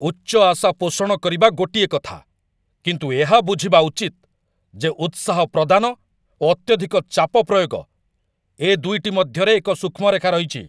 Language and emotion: Odia, angry